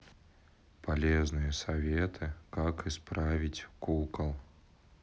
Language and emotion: Russian, sad